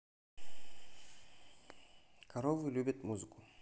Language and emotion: Russian, neutral